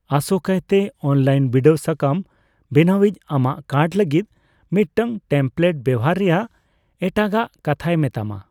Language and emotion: Santali, neutral